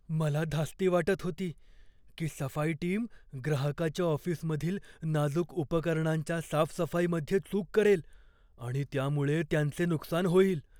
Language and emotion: Marathi, fearful